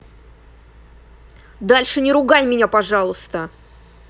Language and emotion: Russian, angry